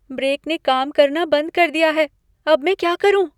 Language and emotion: Hindi, fearful